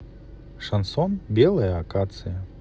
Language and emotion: Russian, neutral